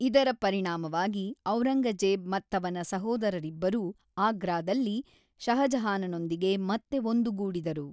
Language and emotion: Kannada, neutral